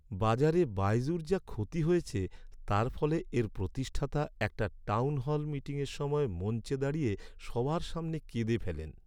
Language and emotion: Bengali, sad